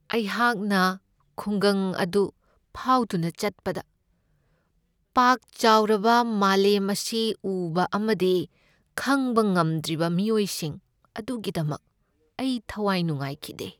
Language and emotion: Manipuri, sad